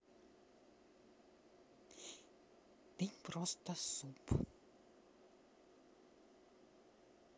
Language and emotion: Russian, neutral